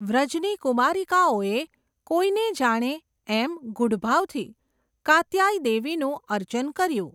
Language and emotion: Gujarati, neutral